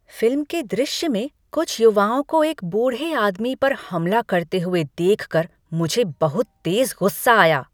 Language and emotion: Hindi, angry